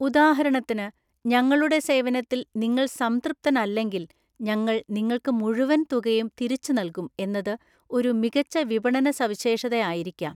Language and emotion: Malayalam, neutral